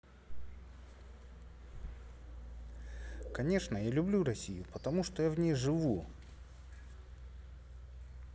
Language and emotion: Russian, neutral